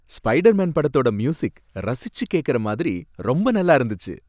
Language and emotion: Tamil, happy